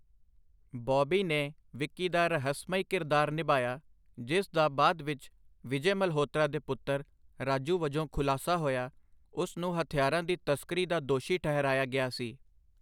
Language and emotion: Punjabi, neutral